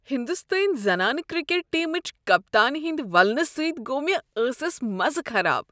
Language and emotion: Kashmiri, disgusted